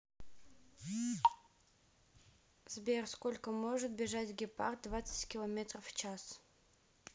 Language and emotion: Russian, neutral